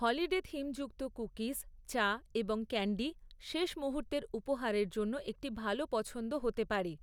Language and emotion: Bengali, neutral